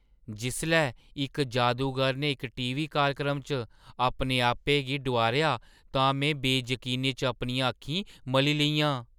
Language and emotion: Dogri, surprised